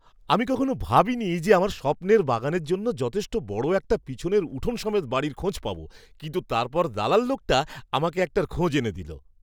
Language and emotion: Bengali, surprised